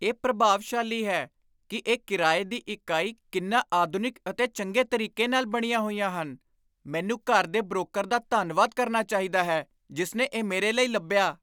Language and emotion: Punjabi, surprised